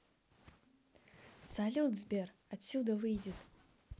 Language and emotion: Russian, positive